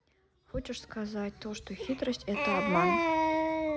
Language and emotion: Russian, neutral